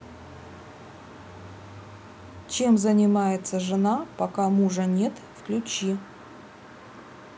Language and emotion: Russian, neutral